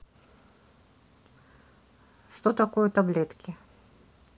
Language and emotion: Russian, neutral